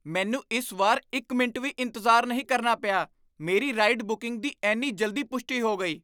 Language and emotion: Punjabi, surprised